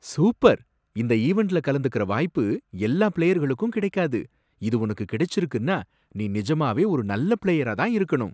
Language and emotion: Tamil, surprised